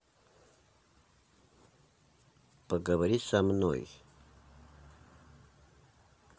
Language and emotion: Russian, neutral